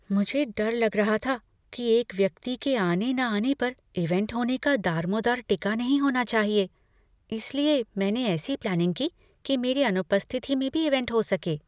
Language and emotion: Hindi, fearful